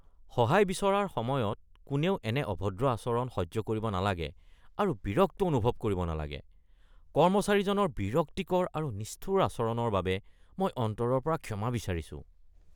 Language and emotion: Assamese, disgusted